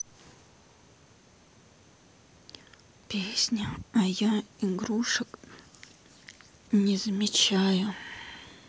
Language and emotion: Russian, sad